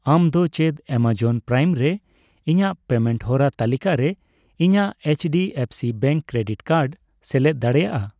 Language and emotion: Santali, neutral